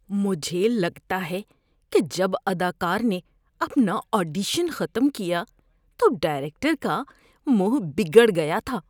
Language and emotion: Urdu, disgusted